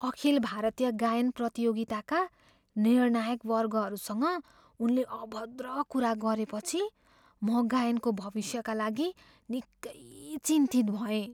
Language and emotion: Nepali, fearful